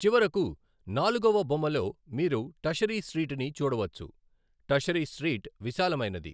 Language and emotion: Telugu, neutral